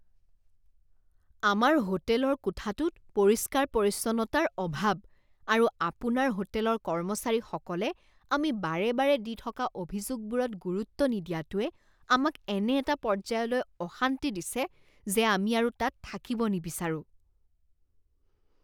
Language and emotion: Assamese, disgusted